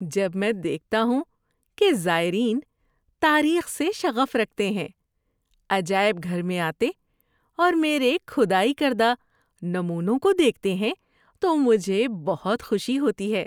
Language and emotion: Urdu, happy